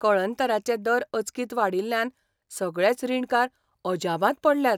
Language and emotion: Goan Konkani, surprised